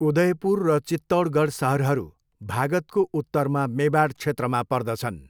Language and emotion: Nepali, neutral